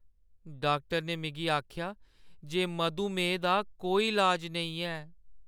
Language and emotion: Dogri, sad